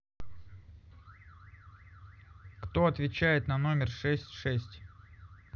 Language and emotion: Russian, neutral